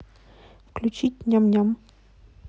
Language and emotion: Russian, neutral